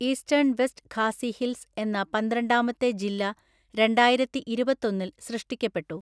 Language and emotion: Malayalam, neutral